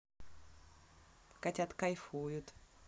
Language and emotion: Russian, positive